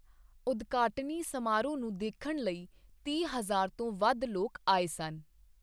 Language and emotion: Punjabi, neutral